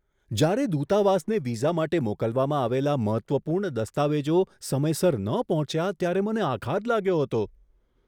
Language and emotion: Gujarati, surprised